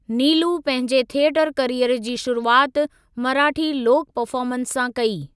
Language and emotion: Sindhi, neutral